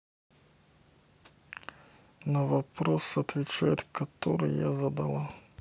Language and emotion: Russian, neutral